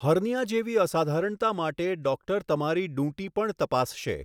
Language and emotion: Gujarati, neutral